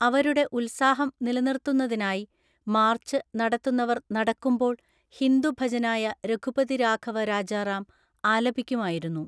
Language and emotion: Malayalam, neutral